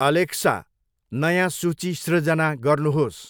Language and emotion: Nepali, neutral